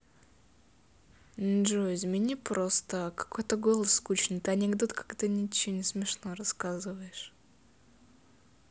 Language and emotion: Russian, neutral